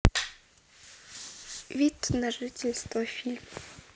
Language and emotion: Russian, neutral